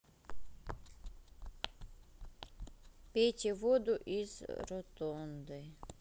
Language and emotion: Russian, neutral